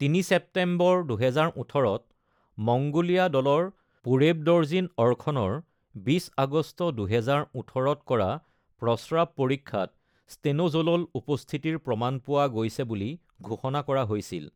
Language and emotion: Assamese, neutral